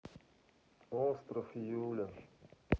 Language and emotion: Russian, sad